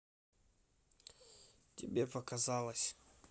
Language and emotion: Russian, neutral